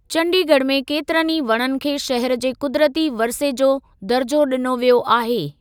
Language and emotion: Sindhi, neutral